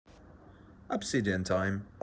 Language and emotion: Russian, neutral